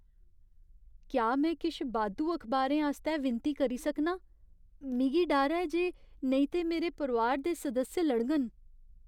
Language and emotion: Dogri, fearful